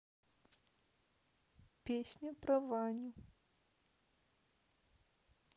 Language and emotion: Russian, sad